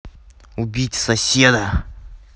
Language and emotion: Russian, angry